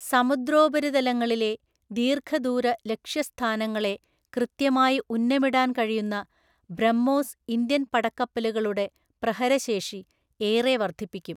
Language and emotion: Malayalam, neutral